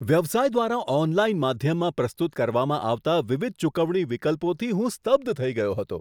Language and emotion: Gujarati, surprised